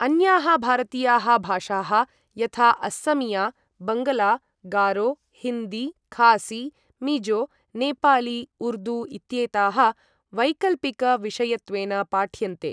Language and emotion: Sanskrit, neutral